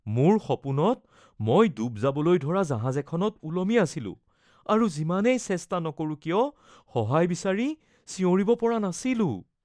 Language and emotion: Assamese, fearful